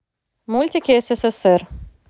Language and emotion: Russian, neutral